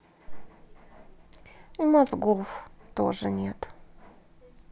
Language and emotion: Russian, sad